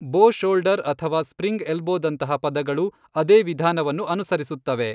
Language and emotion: Kannada, neutral